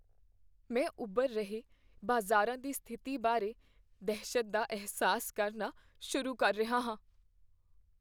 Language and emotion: Punjabi, fearful